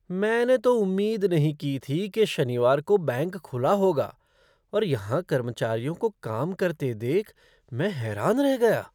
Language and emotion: Hindi, surprised